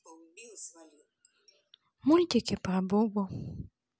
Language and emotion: Russian, sad